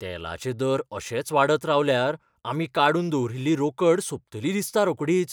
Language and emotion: Goan Konkani, fearful